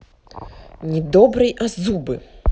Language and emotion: Russian, angry